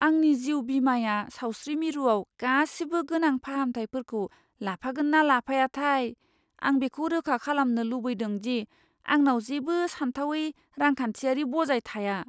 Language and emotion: Bodo, fearful